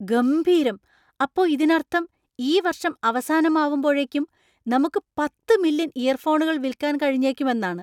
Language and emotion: Malayalam, surprised